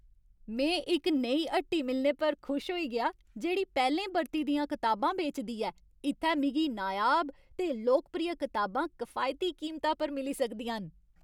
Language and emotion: Dogri, happy